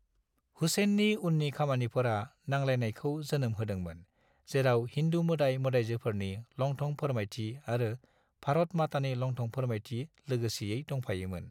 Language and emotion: Bodo, neutral